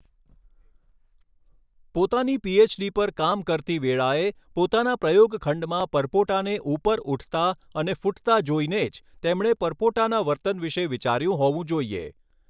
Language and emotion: Gujarati, neutral